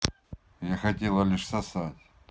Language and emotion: Russian, neutral